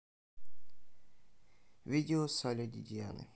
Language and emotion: Russian, neutral